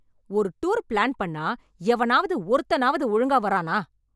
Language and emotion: Tamil, angry